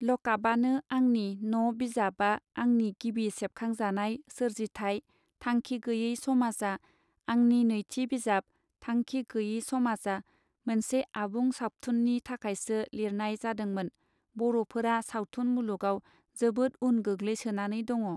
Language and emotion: Bodo, neutral